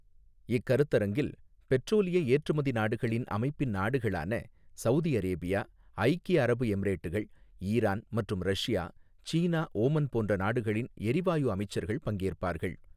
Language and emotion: Tamil, neutral